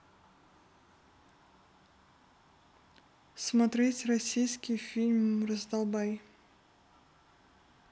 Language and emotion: Russian, neutral